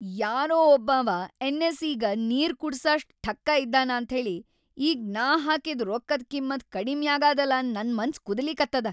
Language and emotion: Kannada, angry